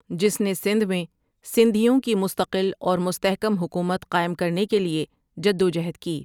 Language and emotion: Urdu, neutral